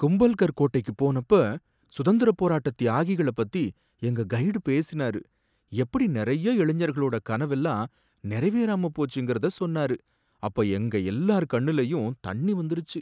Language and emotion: Tamil, sad